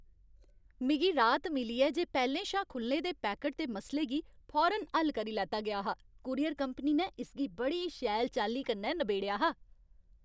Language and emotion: Dogri, happy